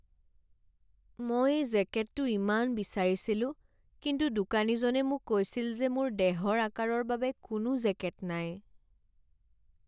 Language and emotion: Assamese, sad